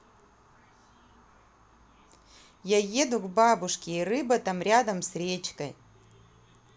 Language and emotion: Russian, positive